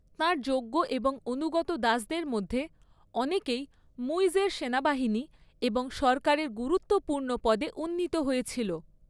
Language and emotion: Bengali, neutral